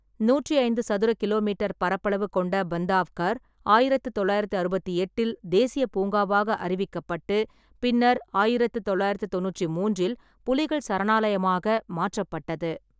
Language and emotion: Tamil, neutral